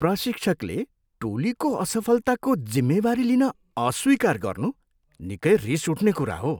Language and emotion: Nepali, disgusted